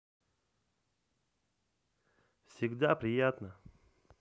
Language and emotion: Russian, positive